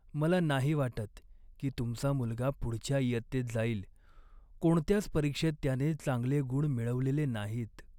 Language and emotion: Marathi, sad